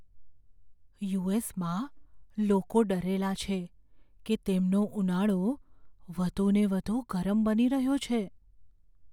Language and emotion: Gujarati, fearful